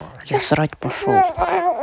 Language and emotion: Russian, neutral